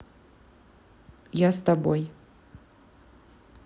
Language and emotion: Russian, neutral